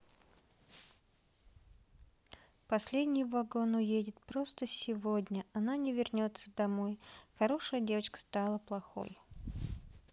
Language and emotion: Russian, sad